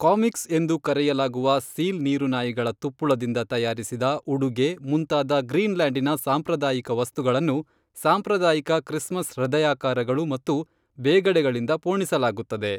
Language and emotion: Kannada, neutral